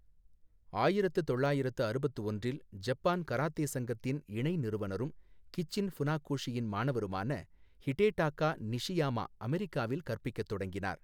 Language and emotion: Tamil, neutral